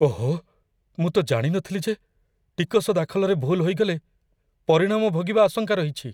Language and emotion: Odia, fearful